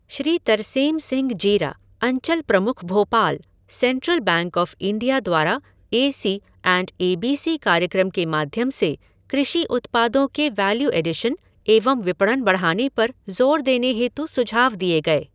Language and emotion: Hindi, neutral